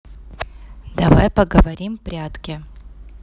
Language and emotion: Russian, neutral